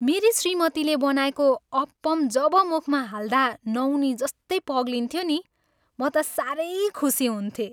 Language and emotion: Nepali, happy